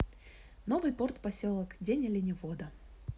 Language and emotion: Russian, positive